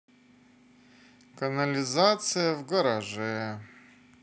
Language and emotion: Russian, sad